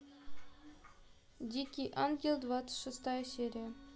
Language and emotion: Russian, neutral